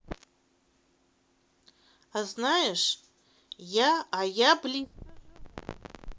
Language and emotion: Russian, neutral